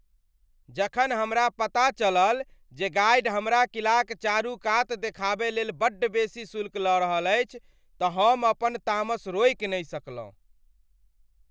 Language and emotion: Maithili, angry